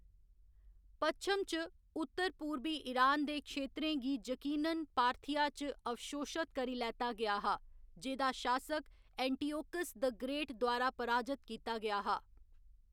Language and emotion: Dogri, neutral